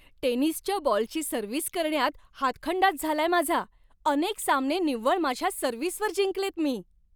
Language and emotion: Marathi, happy